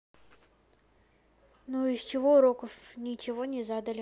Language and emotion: Russian, neutral